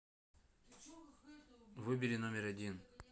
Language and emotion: Russian, neutral